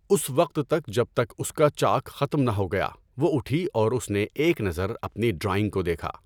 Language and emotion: Urdu, neutral